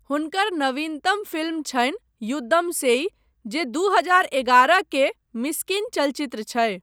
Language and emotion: Maithili, neutral